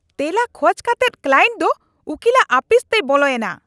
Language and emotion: Santali, angry